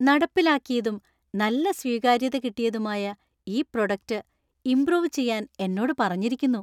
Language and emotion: Malayalam, happy